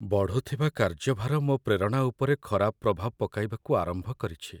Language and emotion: Odia, sad